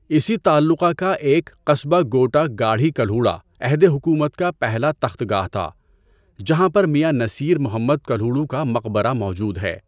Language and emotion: Urdu, neutral